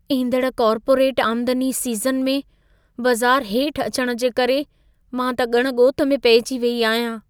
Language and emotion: Sindhi, fearful